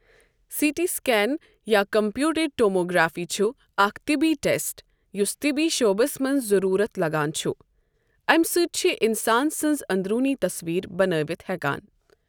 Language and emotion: Kashmiri, neutral